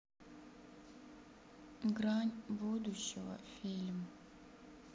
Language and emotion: Russian, sad